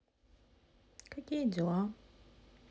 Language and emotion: Russian, neutral